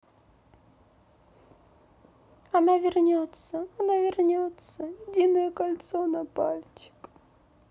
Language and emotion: Russian, sad